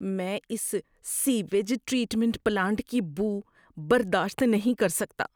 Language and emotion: Urdu, disgusted